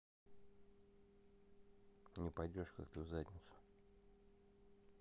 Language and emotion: Russian, neutral